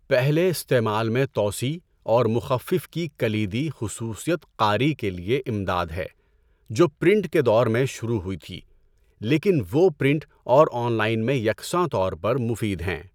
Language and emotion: Urdu, neutral